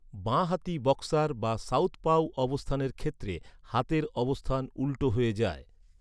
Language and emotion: Bengali, neutral